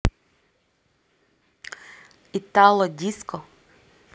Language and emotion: Russian, positive